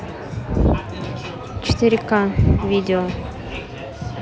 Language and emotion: Russian, neutral